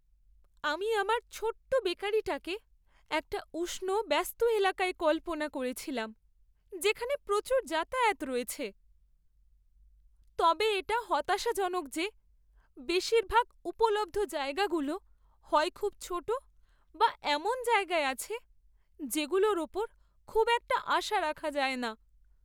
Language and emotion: Bengali, sad